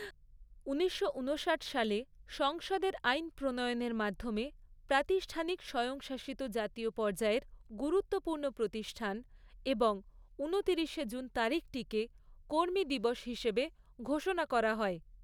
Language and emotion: Bengali, neutral